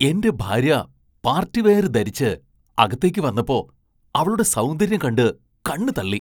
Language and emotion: Malayalam, surprised